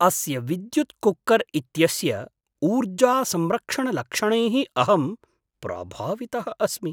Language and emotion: Sanskrit, surprised